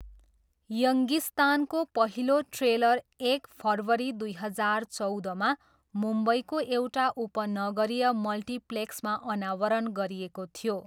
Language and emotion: Nepali, neutral